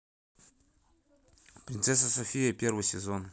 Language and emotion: Russian, neutral